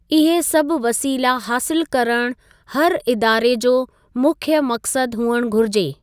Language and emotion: Sindhi, neutral